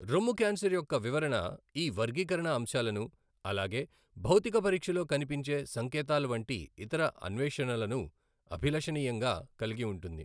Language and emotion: Telugu, neutral